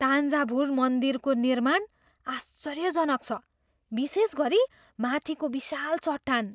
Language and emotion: Nepali, surprised